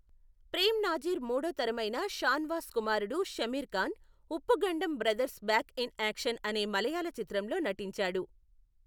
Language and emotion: Telugu, neutral